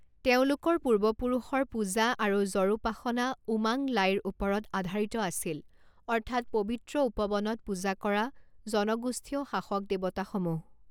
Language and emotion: Assamese, neutral